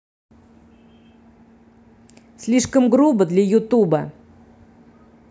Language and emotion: Russian, angry